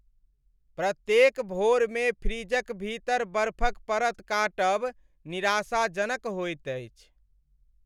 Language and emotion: Maithili, sad